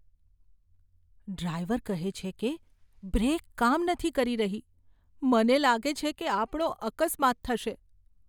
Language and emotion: Gujarati, fearful